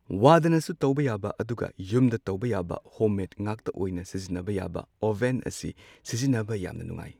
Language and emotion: Manipuri, neutral